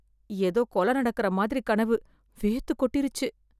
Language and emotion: Tamil, fearful